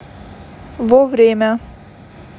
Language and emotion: Russian, neutral